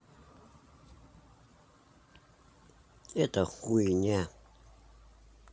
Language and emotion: Russian, neutral